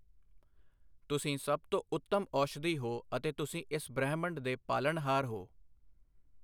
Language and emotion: Punjabi, neutral